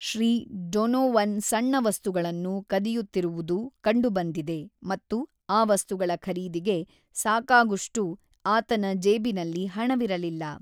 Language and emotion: Kannada, neutral